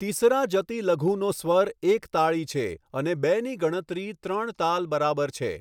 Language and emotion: Gujarati, neutral